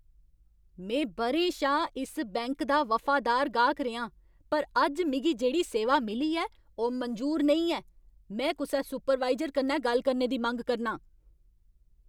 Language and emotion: Dogri, angry